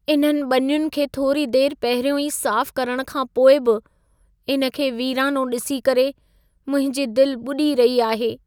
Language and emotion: Sindhi, sad